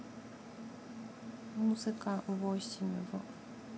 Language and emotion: Russian, neutral